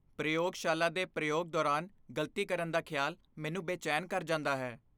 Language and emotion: Punjabi, fearful